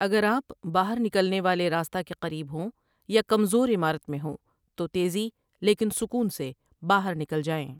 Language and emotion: Urdu, neutral